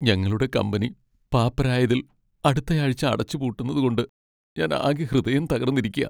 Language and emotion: Malayalam, sad